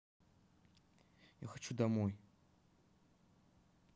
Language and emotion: Russian, sad